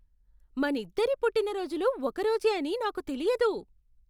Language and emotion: Telugu, surprised